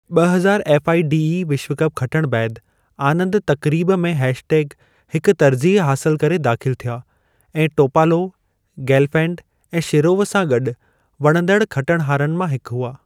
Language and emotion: Sindhi, neutral